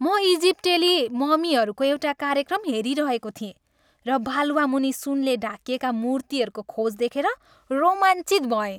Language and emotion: Nepali, happy